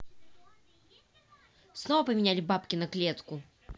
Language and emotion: Russian, angry